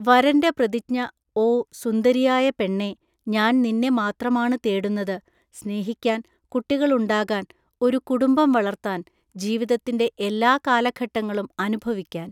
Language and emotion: Malayalam, neutral